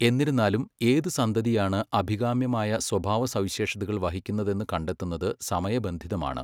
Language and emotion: Malayalam, neutral